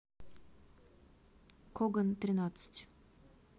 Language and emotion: Russian, neutral